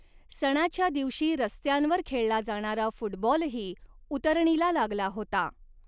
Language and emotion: Marathi, neutral